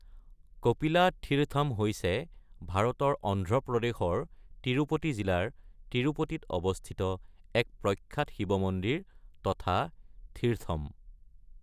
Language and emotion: Assamese, neutral